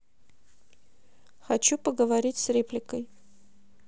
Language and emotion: Russian, neutral